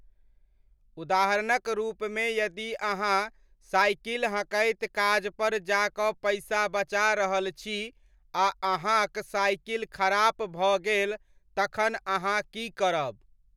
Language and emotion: Maithili, neutral